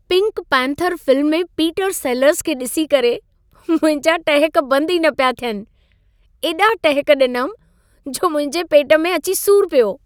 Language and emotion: Sindhi, happy